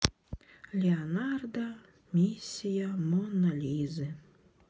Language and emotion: Russian, sad